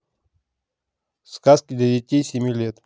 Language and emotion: Russian, neutral